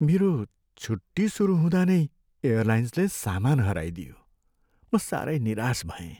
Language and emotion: Nepali, sad